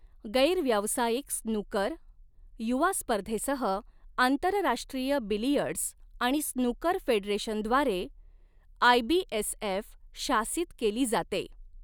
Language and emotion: Marathi, neutral